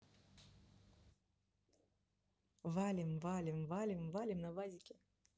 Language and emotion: Russian, neutral